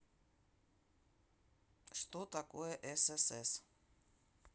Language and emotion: Russian, neutral